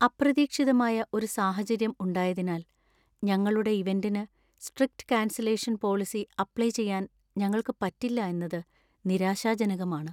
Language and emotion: Malayalam, sad